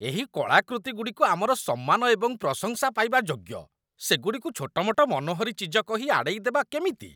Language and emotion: Odia, disgusted